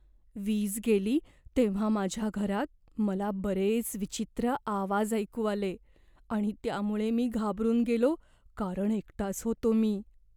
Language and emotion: Marathi, fearful